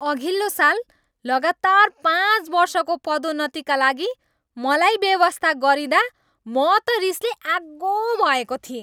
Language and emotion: Nepali, angry